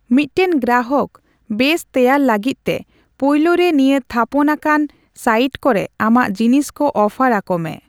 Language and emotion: Santali, neutral